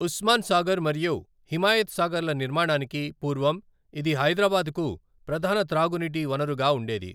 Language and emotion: Telugu, neutral